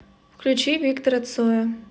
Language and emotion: Russian, neutral